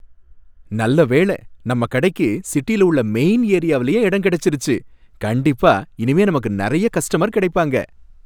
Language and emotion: Tamil, happy